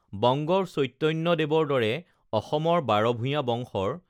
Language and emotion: Assamese, neutral